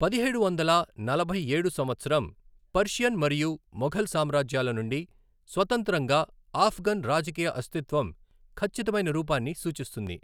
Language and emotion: Telugu, neutral